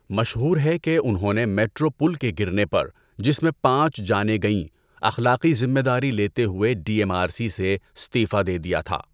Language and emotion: Urdu, neutral